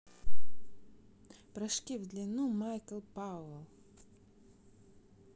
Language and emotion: Russian, neutral